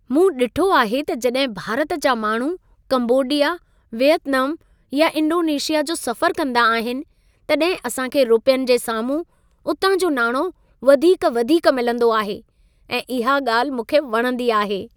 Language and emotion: Sindhi, happy